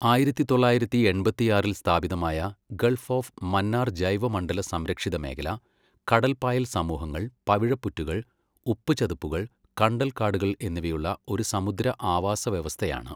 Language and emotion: Malayalam, neutral